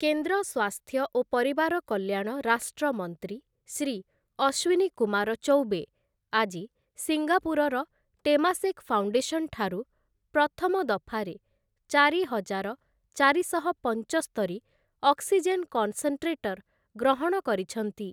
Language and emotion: Odia, neutral